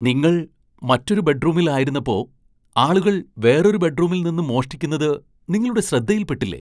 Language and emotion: Malayalam, surprised